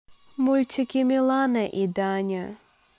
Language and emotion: Russian, neutral